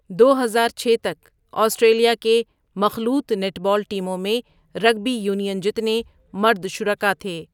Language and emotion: Urdu, neutral